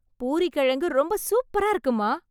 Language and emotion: Tamil, happy